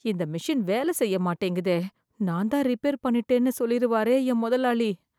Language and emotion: Tamil, fearful